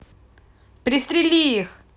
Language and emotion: Russian, angry